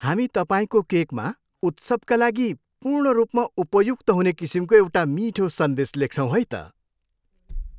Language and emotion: Nepali, happy